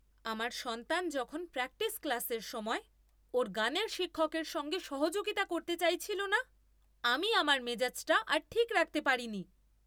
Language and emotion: Bengali, angry